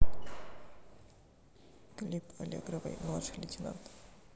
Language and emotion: Russian, neutral